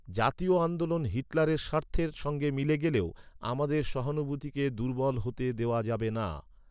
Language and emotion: Bengali, neutral